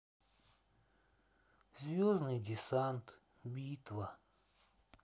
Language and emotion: Russian, sad